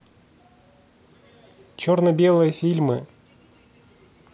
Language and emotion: Russian, neutral